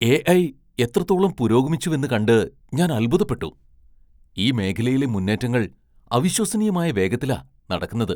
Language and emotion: Malayalam, surprised